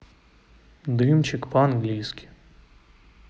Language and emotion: Russian, neutral